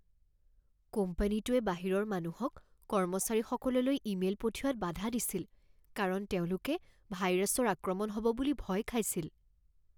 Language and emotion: Assamese, fearful